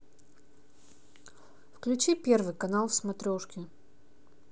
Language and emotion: Russian, neutral